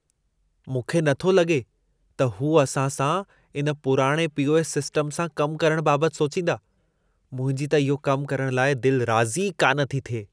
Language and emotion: Sindhi, disgusted